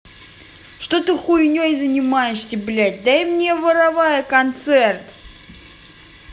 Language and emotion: Russian, angry